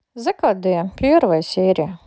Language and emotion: Russian, neutral